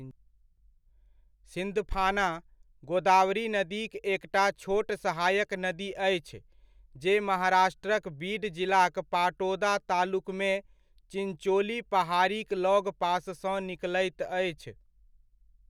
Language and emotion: Maithili, neutral